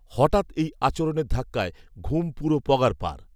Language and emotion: Bengali, neutral